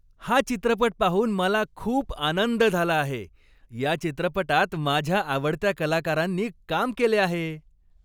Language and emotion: Marathi, happy